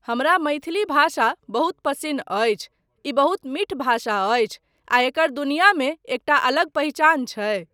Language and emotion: Maithili, neutral